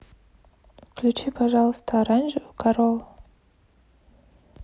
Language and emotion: Russian, neutral